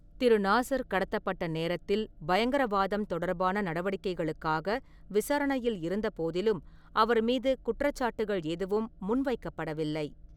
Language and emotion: Tamil, neutral